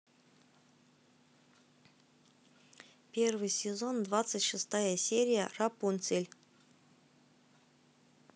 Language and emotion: Russian, neutral